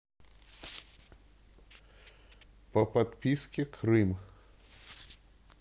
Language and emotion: Russian, neutral